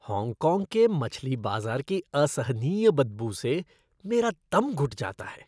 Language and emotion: Hindi, disgusted